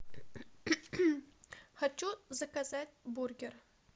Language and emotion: Russian, neutral